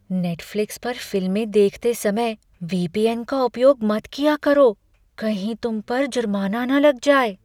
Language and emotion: Hindi, fearful